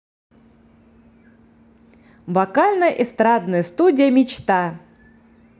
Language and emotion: Russian, positive